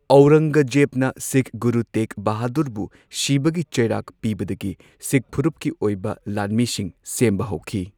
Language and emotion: Manipuri, neutral